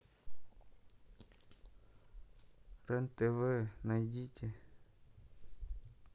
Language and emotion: Russian, neutral